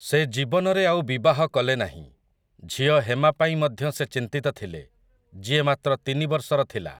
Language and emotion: Odia, neutral